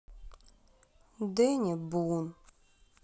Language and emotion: Russian, sad